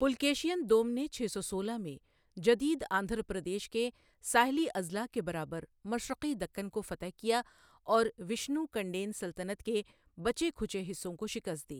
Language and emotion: Urdu, neutral